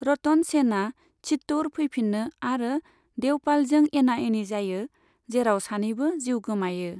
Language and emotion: Bodo, neutral